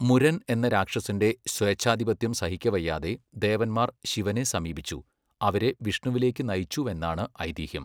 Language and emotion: Malayalam, neutral